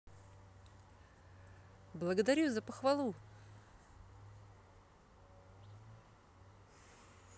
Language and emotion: Russian, positive